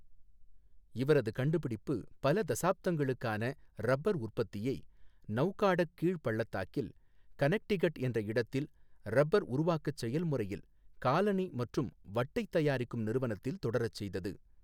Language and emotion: Tamil, neutral